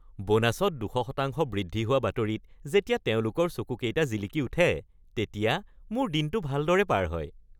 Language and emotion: Assamese, happy